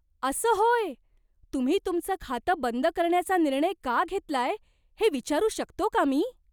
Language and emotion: Marathi, surprised